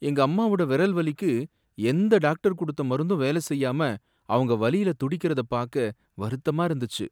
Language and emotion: Tamil, sad